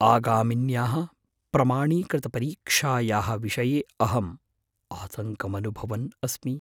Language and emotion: Sanskrit, fearful